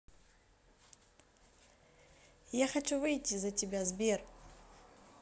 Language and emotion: Russian, positive